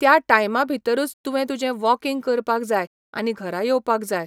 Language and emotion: Goan Konkani, neutral